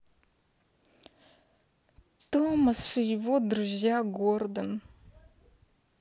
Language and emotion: Russian, sad